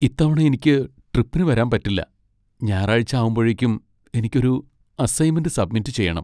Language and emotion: Malayalam, sad